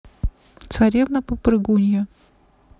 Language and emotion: Russian, neutral